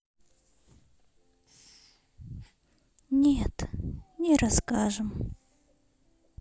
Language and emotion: Russian, sad